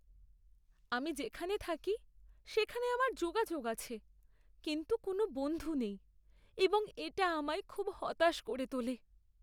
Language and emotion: Bengali, sad